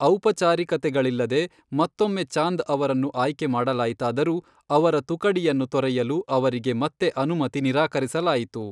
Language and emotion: Kannada, neutral